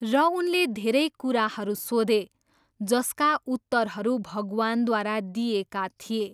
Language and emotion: Nepali, neutral